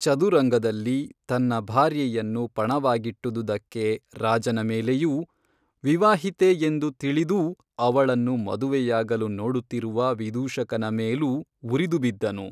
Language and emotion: Kannada, neutral